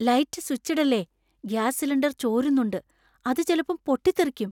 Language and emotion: Malayalam, fearful